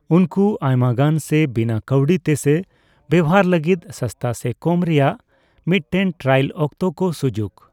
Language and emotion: Santali, neutral